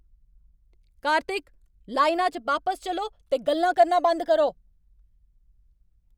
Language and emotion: Dogri, angry